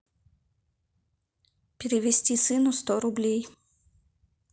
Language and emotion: Russian, neutral